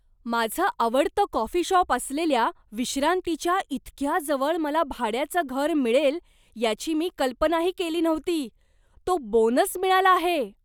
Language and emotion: Marathi, surprised